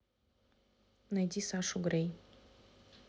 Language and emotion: Russian, neutral